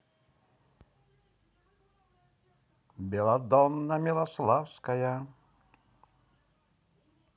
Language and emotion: Russian, positive